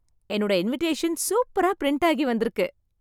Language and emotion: Tamil, happy